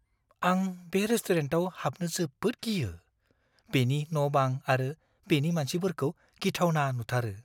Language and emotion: Bodo, fearful